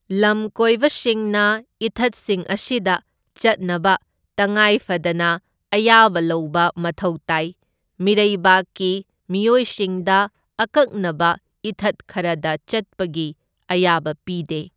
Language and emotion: Manipuri, neutral